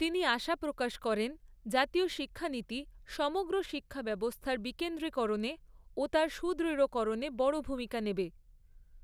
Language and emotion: Bengali, neutral